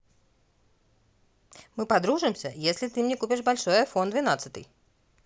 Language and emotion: Russian, neutral